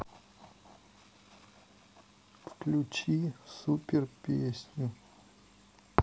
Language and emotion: Russian, neutral